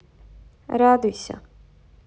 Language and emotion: Russian, neutral